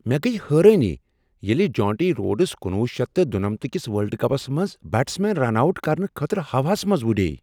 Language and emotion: Kashmiri, surprised